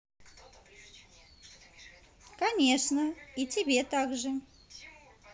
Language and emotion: Russian, positive